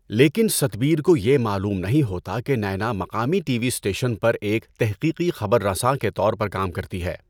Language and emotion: Urdu, neutral